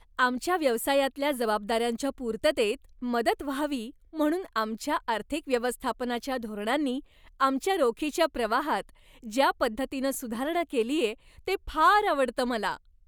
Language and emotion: Marathi, happy